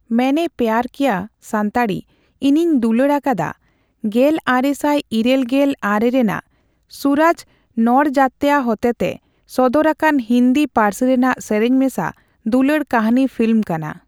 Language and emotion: Santali, neutral